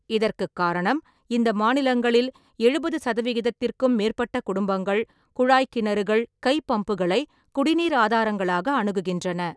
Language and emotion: Tamil, neutral